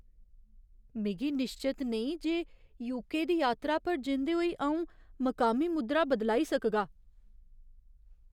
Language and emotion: Dogri, fearful